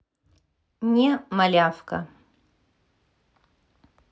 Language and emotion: Russian, neutral